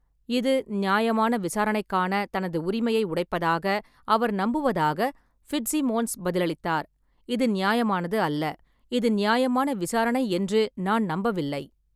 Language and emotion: Tamil, neutral